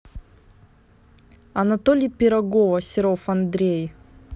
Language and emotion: Russian, neutral